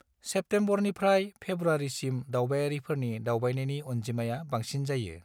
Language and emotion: Bodo, neutral